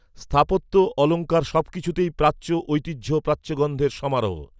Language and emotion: Bengali, neutral